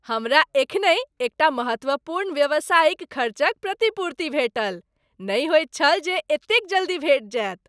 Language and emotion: Maithili, happy